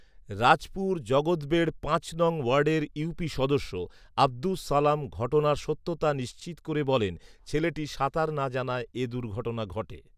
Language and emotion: Bengali, neutral